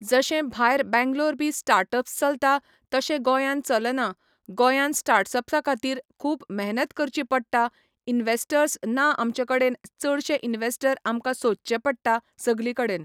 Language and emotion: Goan Konkani, neutral